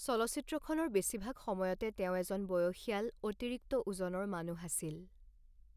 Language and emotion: Assamese, neutral